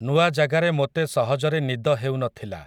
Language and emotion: Odia, neutral